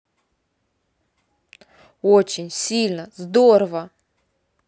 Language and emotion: Russian, positive